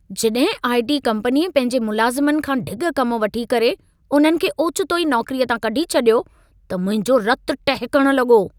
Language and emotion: Sindhi, angry